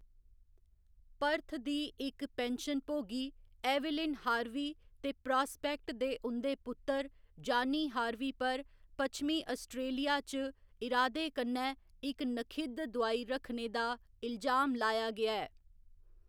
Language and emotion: Dogri, neutral